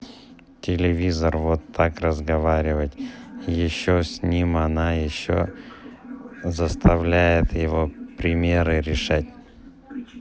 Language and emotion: Russian, neutral